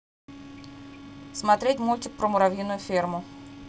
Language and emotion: Russian, neutral